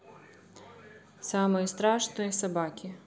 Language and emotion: Russian, neutral